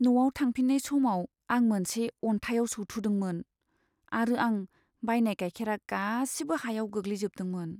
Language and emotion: Bodo, sad